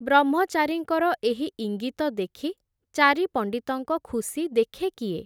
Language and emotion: Odia, neutral